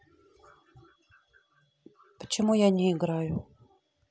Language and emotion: Russian, neutral